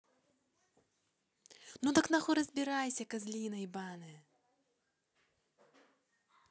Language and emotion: Russian, angry